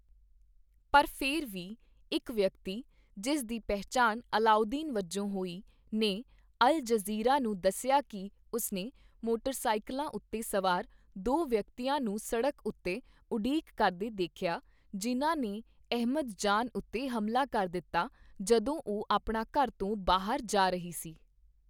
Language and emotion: Punjabi, neutral